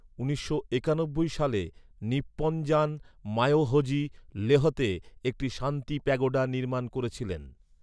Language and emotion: Bengali, neutral